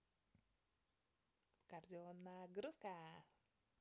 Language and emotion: Russian, positive